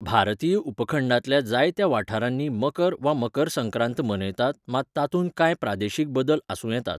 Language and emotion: Goan Konkani, neutral